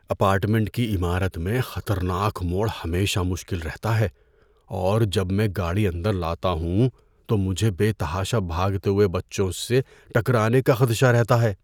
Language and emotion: Urdu, fearful